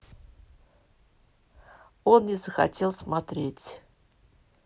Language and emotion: Russian, neutral